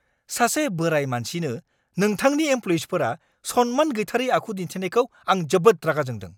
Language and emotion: Bodo, angry